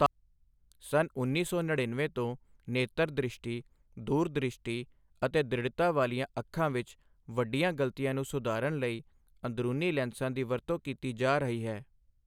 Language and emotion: Punjabi, neutral